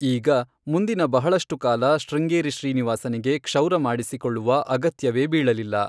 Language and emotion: Kannada, neutral